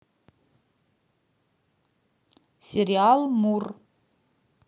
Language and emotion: Russian, neutral